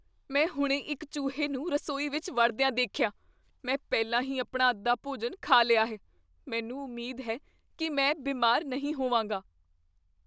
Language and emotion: Punjabi, fearful